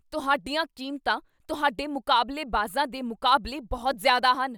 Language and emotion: Punjabi, angry